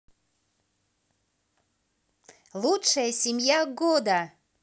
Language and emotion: Russian, positive